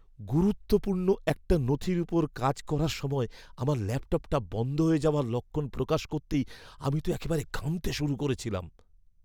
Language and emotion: Bengali, fearful